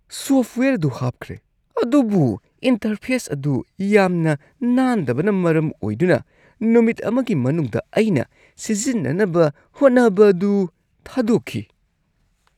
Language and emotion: Manipuri, disgusted